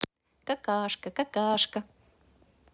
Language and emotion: Russian, positive